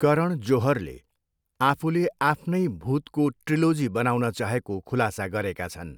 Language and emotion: Nepali, neutral